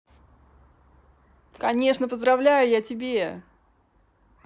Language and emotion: Russian, positive